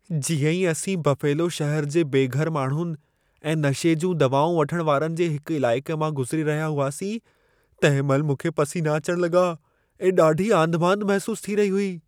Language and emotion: Sindhi, fearful